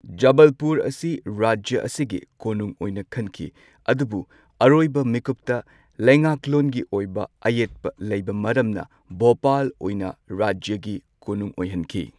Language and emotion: Manipuri, neutral